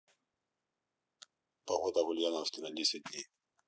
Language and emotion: Russian, neutral